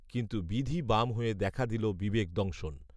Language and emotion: Bengali, neutral